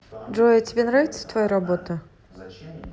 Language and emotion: Russian, neutral